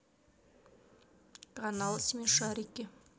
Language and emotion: Russian, neutral